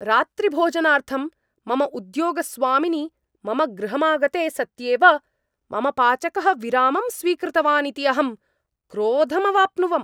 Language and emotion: Sanskrit, angry